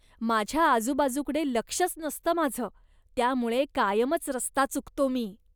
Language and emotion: Marathi, disgusted